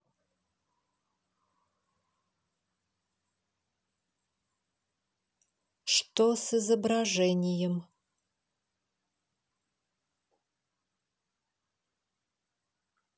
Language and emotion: Russian, neutral